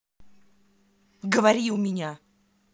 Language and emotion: Russian, angry